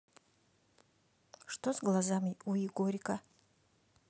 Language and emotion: Russian, neutral